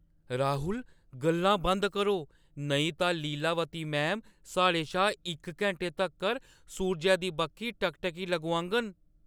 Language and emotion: Dogri, fearful